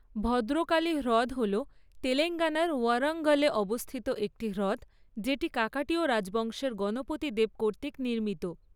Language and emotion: Bengali, neutral